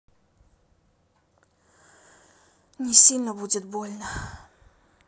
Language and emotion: Russian, sad